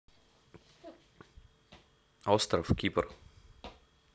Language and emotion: Russian, neutral